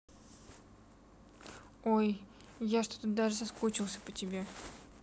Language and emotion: Russian, sad